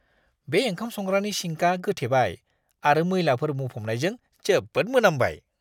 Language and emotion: Bodo, disgusted